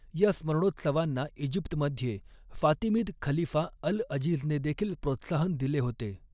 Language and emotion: Marathi, neutral